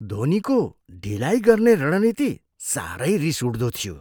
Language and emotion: Nepali, disgusted